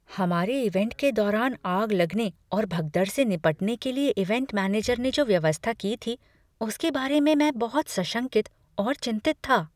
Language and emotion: Hindi, fearful